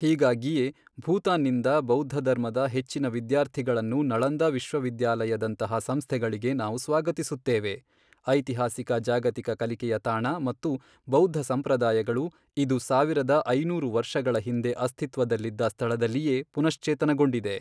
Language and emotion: Kannada, neutral